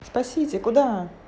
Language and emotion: Russian, neutral